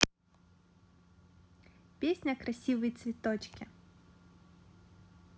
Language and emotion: Russian, positive